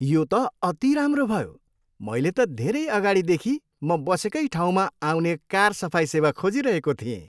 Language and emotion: Nepali, happy